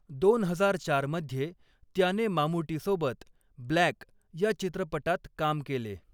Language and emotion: Marathi, neutral